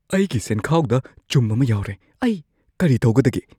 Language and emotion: Manipuri, fearful